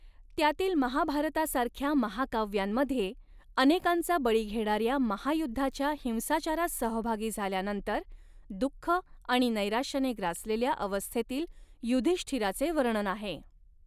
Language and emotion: Marathi, neutral